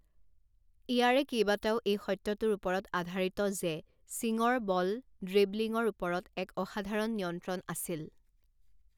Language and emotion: Assamese, neutral